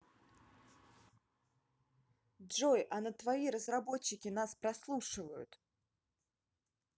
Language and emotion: Russian, neutral